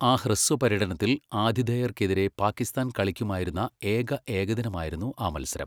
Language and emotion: Malayalam, neutral